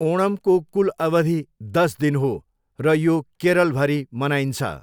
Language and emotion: Nepali, neutral